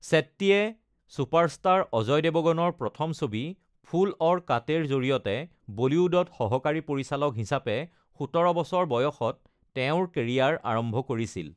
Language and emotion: Assamese, neutral